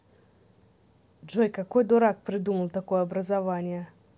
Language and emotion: Russian, neutral